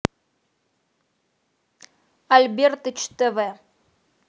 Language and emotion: Russian, neutral